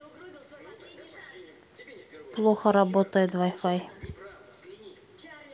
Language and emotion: Russian, neutral